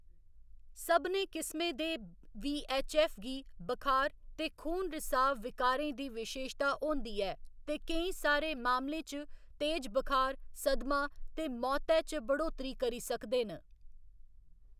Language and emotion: Dogri, neutral